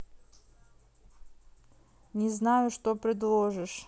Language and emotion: Russian, neutral